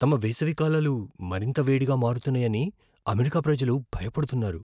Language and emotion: Telugu, fearful